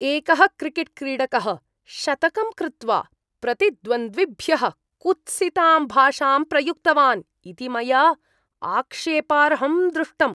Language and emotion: Sanskrit, disgusted